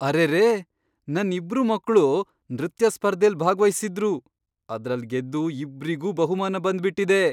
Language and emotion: Kannada, surprised